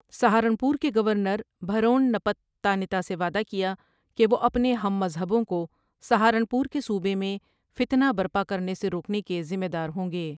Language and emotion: Urdu, neutral